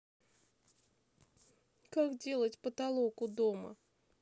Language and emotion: Russian, sad